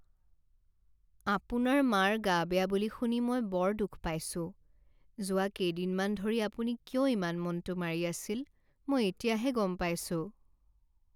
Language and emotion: Assamese, sad